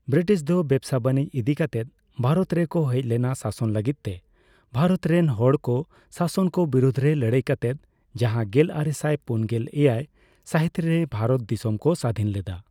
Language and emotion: Santali, neutral